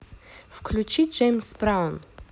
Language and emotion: Russian, positive